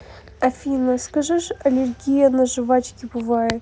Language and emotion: Russian, neutral